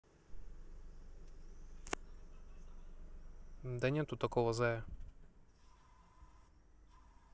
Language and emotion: Russian, neutral